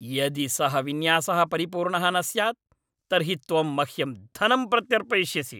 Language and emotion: Sanskrit, angry